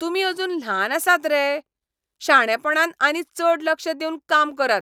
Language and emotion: Goan Konkani, angry